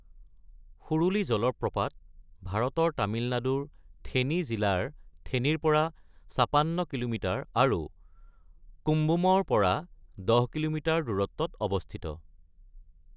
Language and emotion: Assamese, neutral